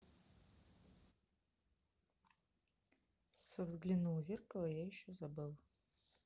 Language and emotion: Russian, neutral